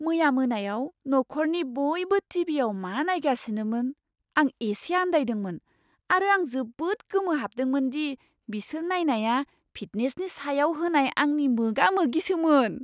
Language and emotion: Bodo, surprised